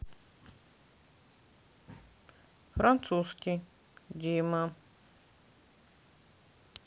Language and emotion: Russian, neutral